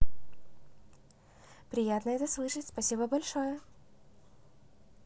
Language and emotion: Russian, positive